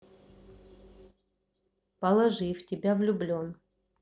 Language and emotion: Russian, neutral